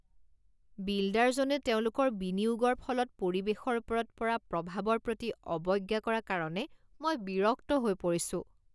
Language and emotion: Assamese, disgusted